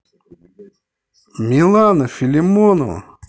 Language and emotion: Russian, positive